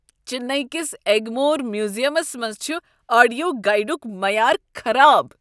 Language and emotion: Kashmiri, disgusted